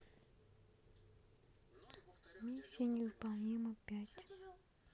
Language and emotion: Russian, neutral